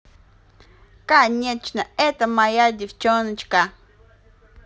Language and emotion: Russian, positive